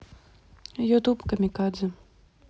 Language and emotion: Russian, neutral